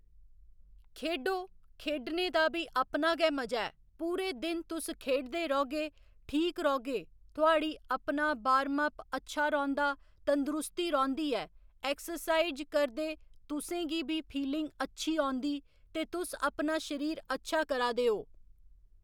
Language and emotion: Dogri, neutral